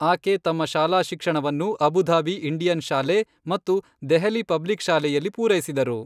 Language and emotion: Kannada, neutral